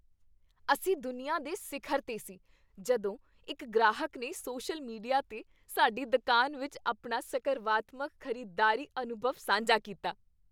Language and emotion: Punjabi, happy